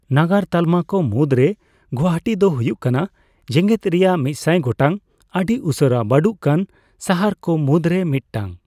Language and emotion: Santali, neutral